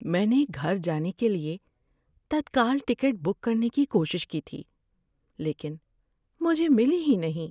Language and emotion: Urdu, sad